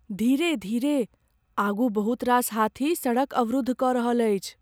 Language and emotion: Maithili, fearful